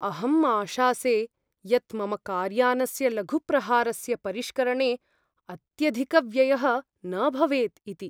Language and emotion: Sanskrit, fearful